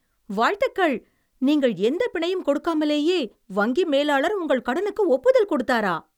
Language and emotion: Tamil, surprised